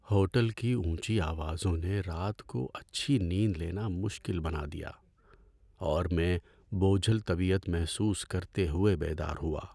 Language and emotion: Urdu, sad